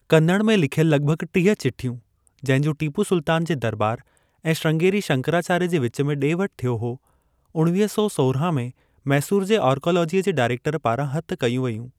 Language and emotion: Sindhi, neutral